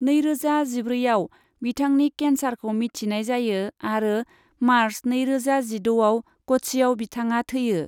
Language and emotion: Bodo, neutral